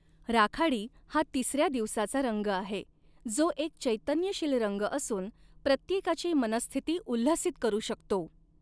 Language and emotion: Marathi, neutral